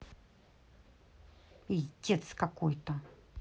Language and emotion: Russian, angry